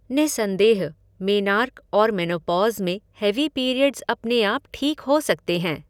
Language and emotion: Hindi, neutral